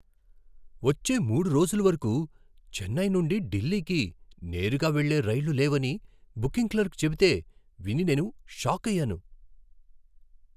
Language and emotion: Telugu, surprised